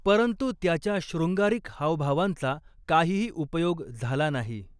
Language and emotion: Marathi, neutral